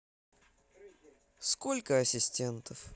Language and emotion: Russian, neutral